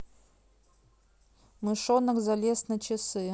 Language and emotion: Russian, neutral